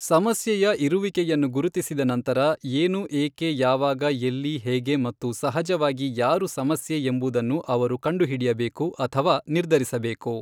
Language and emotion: Kannada, neutral